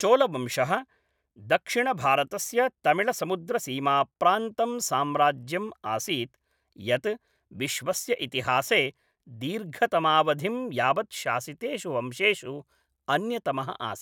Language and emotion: Sanskrit, neutral